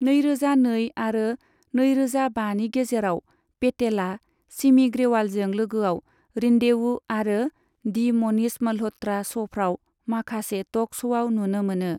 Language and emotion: Bodo, neutral